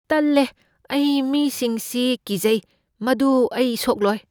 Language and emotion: Manipuri, fearful